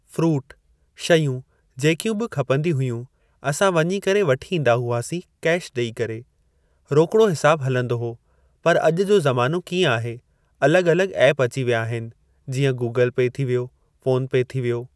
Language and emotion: Sindhi, neutral